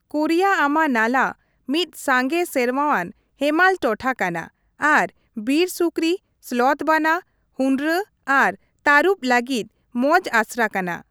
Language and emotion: Santali, neutral